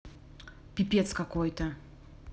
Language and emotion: Russian, angry